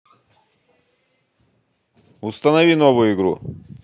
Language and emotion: Russian, angry